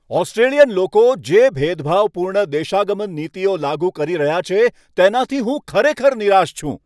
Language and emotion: Gujarati, angry